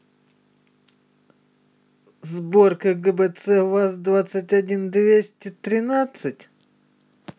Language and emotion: Russian, neutral